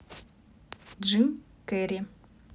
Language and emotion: Russian, neutral